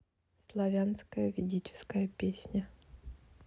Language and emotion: Russian, neutral